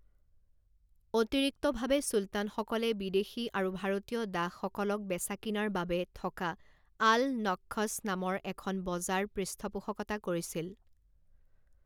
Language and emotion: Assamese, neutral